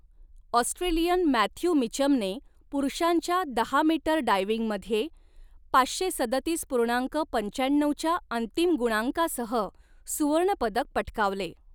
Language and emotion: Marathi, neutral